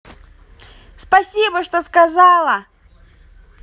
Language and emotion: Russian, positive